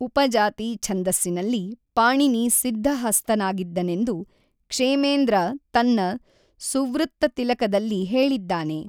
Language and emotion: Kannada, neutral